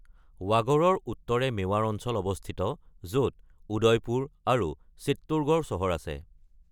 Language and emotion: Assamese, neutral